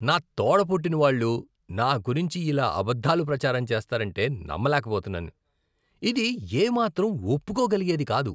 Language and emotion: Telugu, disgusted